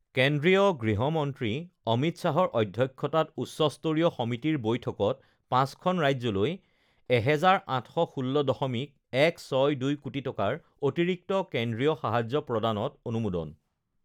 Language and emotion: Assamese, neutral